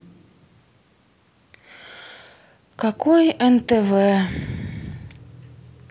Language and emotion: Russian, sad